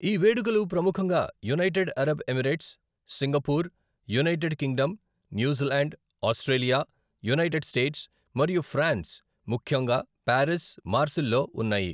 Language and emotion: Telugu, neutral